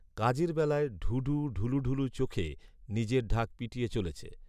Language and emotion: Bengali, neutral